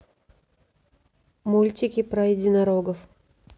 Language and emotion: Russian, neutral